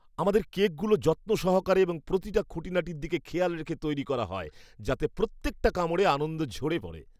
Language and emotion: Bengali, happy